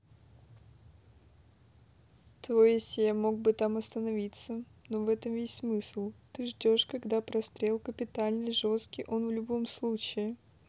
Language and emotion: Russian, neutral